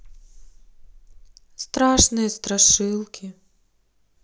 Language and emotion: Russian, sad